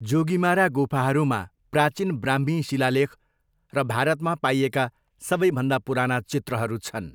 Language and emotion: Nepali, neutral